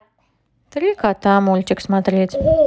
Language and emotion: Russian, neutral